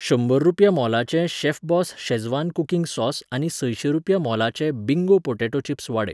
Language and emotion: Goan Konkani, neutral